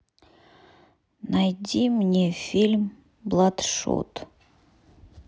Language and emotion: Russian, neutral